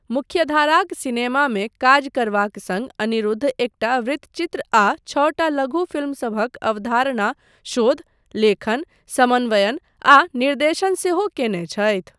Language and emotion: Maithili, neutral